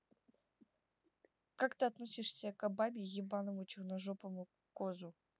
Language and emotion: Russian, neutral